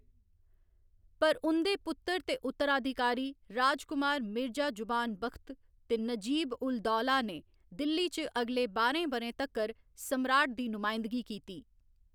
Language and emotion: Dogri, neutral